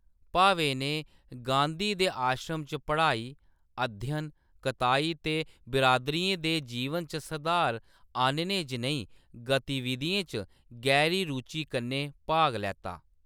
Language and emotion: Dogri, neutral